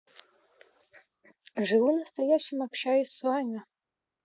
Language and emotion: Russian, neutral